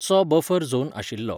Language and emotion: Goan Konkani, neutral